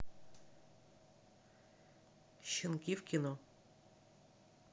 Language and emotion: Russian, neutral